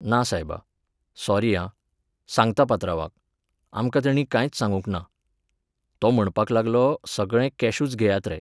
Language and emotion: Goan Konkani, neutral